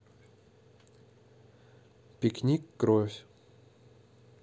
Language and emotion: Russian, neutral